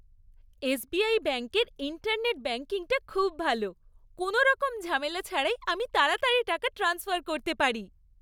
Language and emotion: Bengali, happy